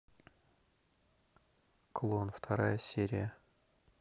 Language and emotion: Russian, neutral